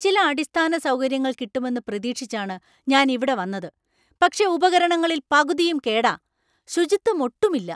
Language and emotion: Malayalam, angry